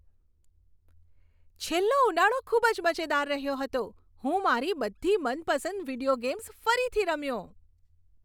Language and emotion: Gujarati, happy